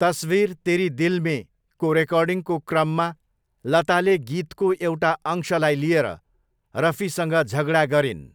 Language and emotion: Nepali, neutral